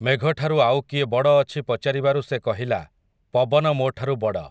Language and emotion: Odia, neutral